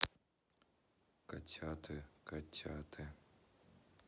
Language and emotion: Russian, neutral